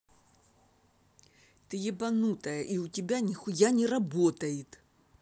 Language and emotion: Russian, angry